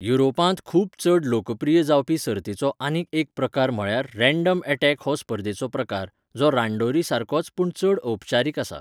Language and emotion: Goan Konkani, neutral